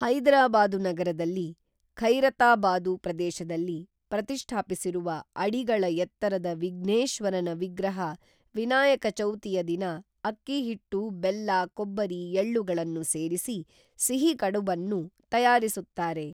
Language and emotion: Kannada, neutral